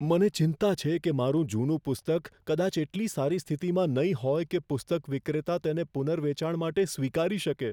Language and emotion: Gujarati, fearful